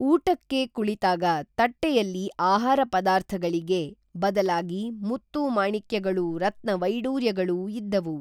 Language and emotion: Kannada, neutral